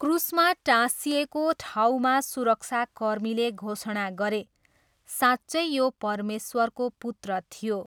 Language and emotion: Nepali, neutral